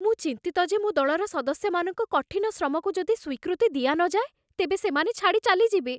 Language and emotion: Odia, fearful